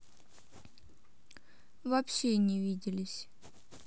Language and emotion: Russian, neutral